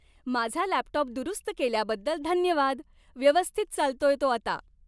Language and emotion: Marathi, happy